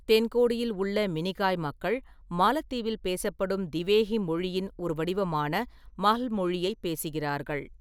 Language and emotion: Tamil, neutral